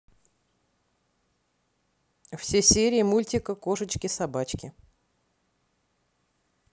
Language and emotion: Russian, neutral